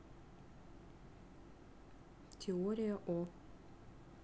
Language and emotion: Russian, neutral